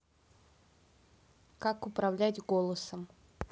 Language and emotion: Russian, neutral